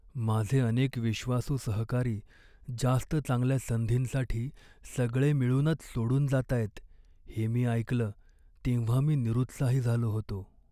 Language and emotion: Marathi, sad